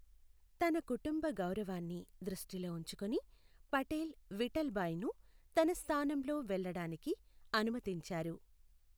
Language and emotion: Telugu, neutral